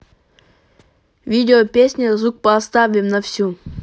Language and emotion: Russian, neutral